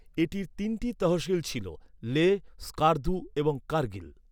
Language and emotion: Bengali, neutral